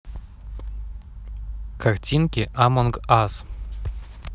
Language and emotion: Russian, neutral